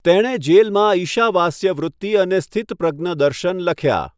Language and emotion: Gujarati, neutral